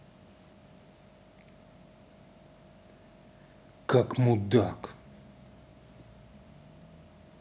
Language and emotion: Russian, angry